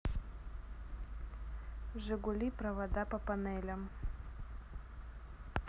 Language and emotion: Russian, neutral